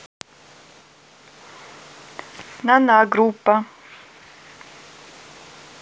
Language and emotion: Russian, neutral